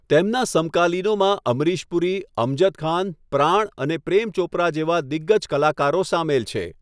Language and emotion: Gujarati, neutral